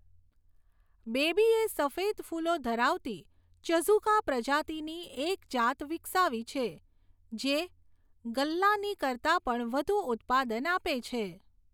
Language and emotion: Gujarati, neutral